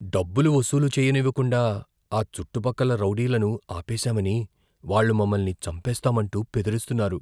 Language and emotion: Telugu, fearful